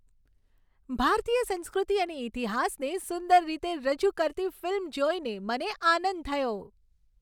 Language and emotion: Gujarati, happy